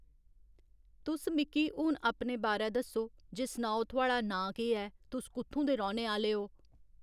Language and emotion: Dogri, neutral